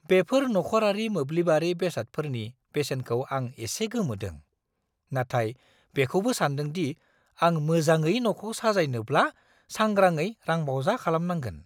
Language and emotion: Bodo, surprised